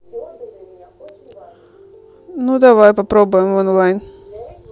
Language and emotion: Russian, neutral